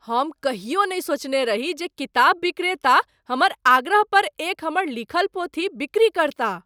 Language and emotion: Maithili, surprised